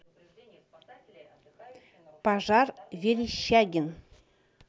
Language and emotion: Russian, neutral